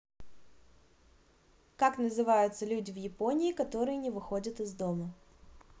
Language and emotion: Russian, neutral